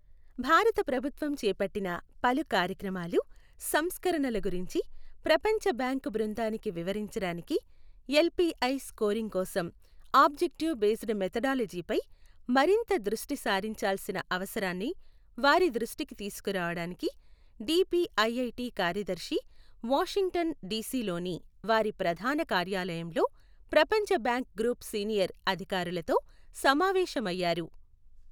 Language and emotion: Telugu, neutral